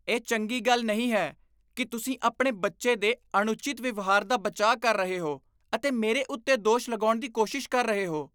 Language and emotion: Punjabi, disgusted